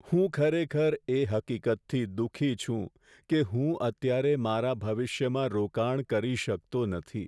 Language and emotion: Gujarati, sad